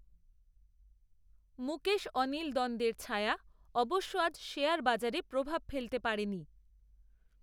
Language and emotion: Bengali, neutral